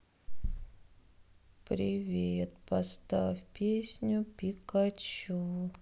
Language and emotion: Russian, sad